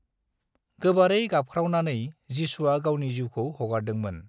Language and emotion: Bodo, neutral